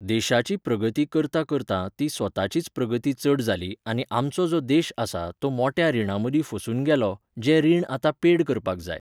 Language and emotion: Goan Konkani, neutral